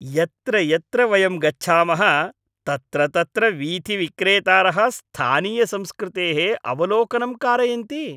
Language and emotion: Sanskrit, happy